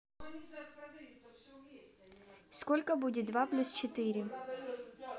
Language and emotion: Russian, neutral